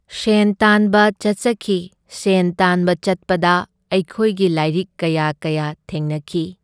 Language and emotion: Manipuri, neutral